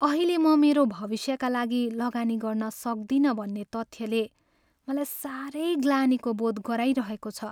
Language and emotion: Nepali, sad